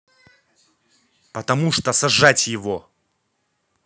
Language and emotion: Russian, angry